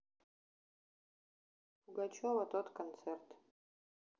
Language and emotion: Russian, neutral